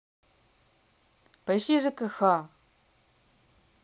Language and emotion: Russian, neutral